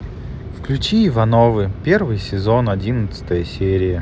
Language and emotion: Russian, sad